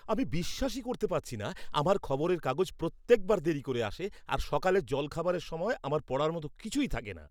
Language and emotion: Bengali, angry